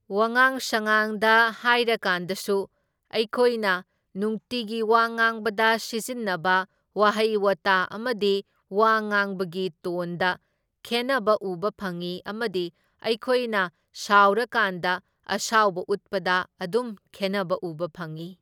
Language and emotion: Manipuri, neutral